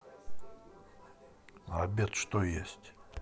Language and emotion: Russian, neutral